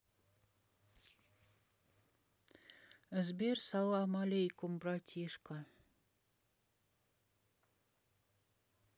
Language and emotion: Russian, neutral